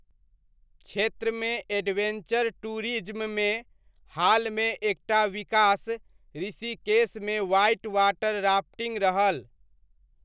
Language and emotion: Maithili, neutral